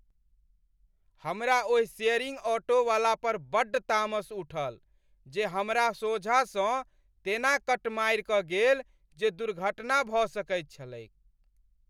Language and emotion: Maithili, angry